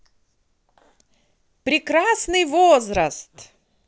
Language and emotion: Russian, positive